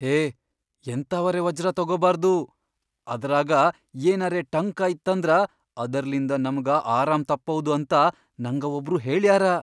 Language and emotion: Kannada, fearful